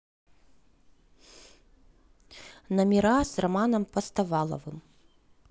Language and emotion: Russian, neutral